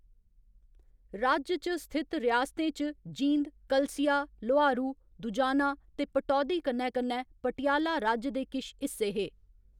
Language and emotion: Dogri, neutral